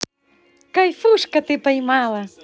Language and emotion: Russian, positive